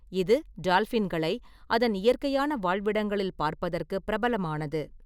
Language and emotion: Tamil, neutral